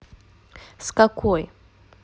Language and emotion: Russian, neutral